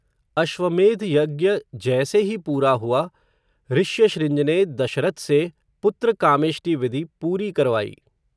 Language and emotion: Hindi, neutral